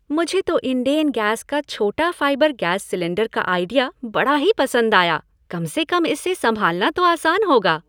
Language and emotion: Hindi, happy